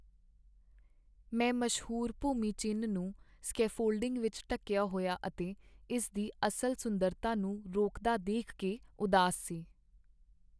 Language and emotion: Punjabi, sad